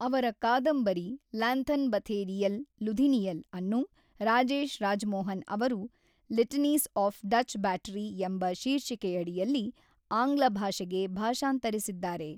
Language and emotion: Kannada, neutral